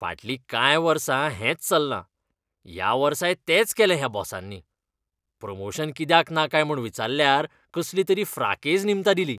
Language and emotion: Goan Konkani, disgusted